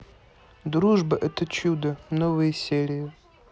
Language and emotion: Russian, neutral